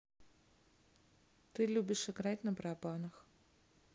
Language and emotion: Russian, neutral